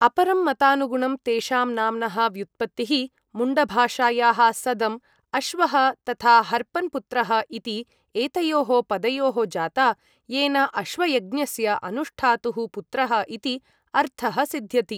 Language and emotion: Sanskrit, neutral